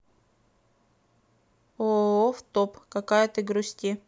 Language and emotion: Russian, neutral